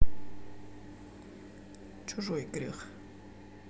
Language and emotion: Russian, neutral